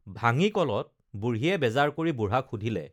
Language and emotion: Assamese, neutral